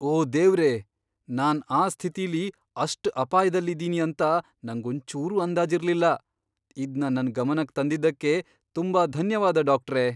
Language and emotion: Kannada, surprised